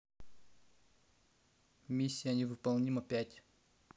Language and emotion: Russian, neutral